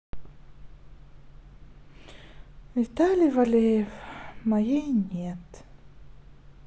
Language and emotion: Russian, sad